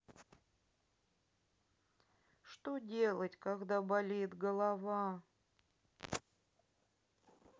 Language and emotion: Russian, sad